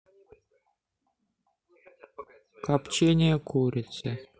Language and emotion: Russian, sad